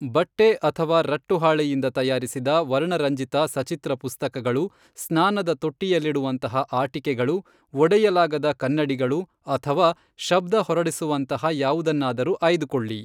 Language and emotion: Kannada, neutral